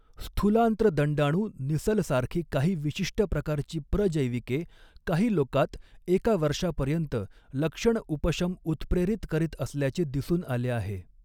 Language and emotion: Marathi, neutral